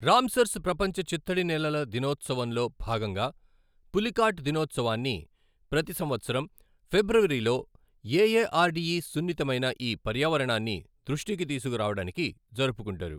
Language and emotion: Telugu, neutral